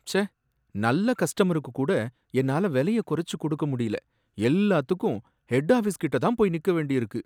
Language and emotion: Tamil, sad